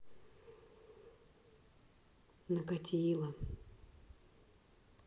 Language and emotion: Russian, sad